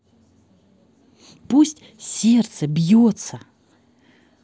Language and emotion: Russian, positive